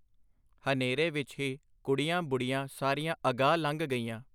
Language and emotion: Punjabi, neutral